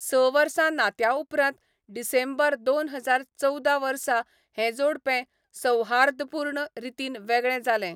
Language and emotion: Goan Konkani, neutral